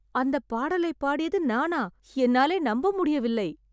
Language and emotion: Tamil, surprised